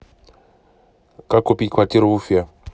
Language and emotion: Russian, neutral